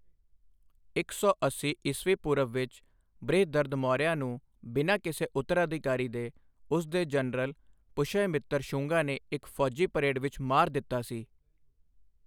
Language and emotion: Punjabi, neutral